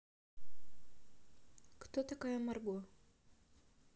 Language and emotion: Russian, neutral